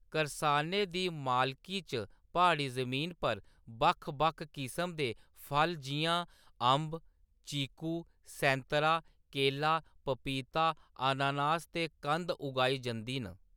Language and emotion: Dogri, neutral